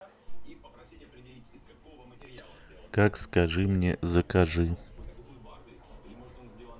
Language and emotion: Russian, neutral